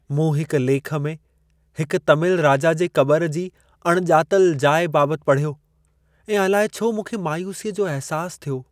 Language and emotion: Sindhi, sad